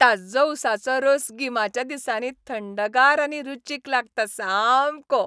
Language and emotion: Goan Konkani, happy